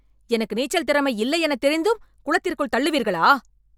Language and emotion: Tamil, angry